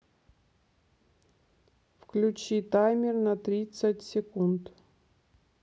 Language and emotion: Russian, neutral